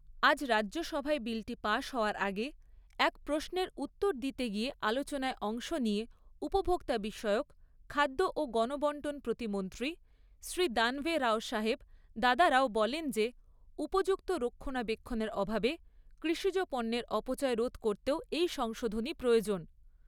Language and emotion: Bengali, neutral